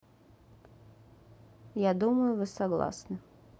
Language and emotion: Russian, neutral